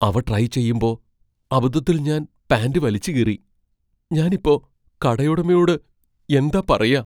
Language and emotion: Malayalam, fearful